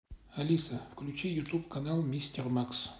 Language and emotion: Russian, neutral